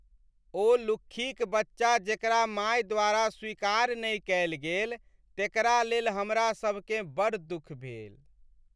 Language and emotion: Maithili, sad